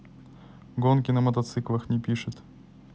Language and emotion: Russian, neutral